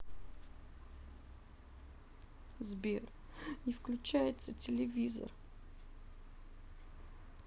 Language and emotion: Russian, sad